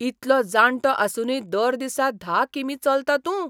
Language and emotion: Goan Konkani, surprised